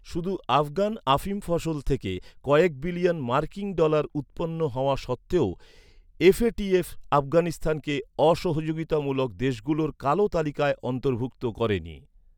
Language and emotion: Bengali, neutral